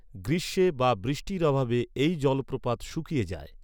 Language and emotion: Bengali, neutral